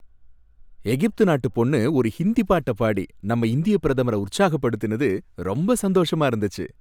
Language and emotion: Tamil, happy